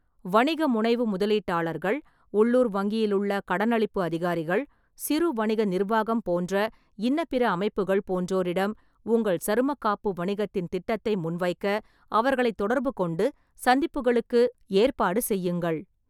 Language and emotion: Tamil, neutral